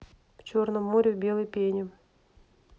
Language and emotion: Russian, neutral